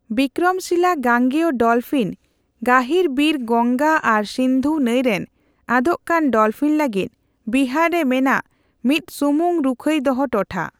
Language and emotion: Santali, neutral